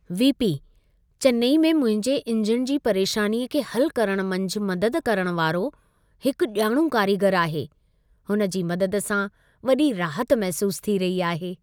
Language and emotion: Sindhi, happy